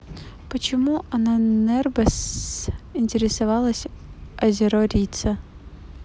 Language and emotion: Russian, neutral